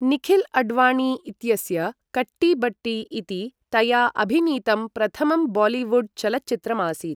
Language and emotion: Sanskrit, neutral